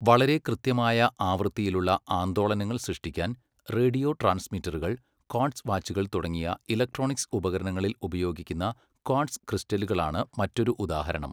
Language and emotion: Malayalam, neutral